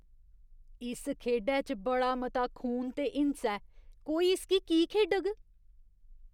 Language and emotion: Dogri, disgusted